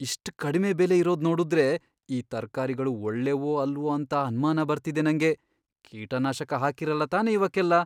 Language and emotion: Kannada, fearful